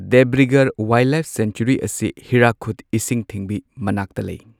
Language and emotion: Manipuri, neutral